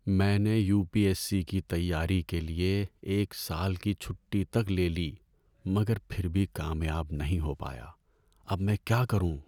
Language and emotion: Urdu, sad